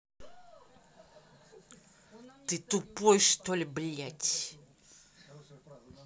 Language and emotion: Russian, angry